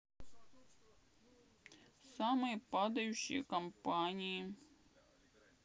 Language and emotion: Russian, sad